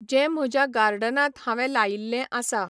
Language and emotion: Goan Konkani, neutral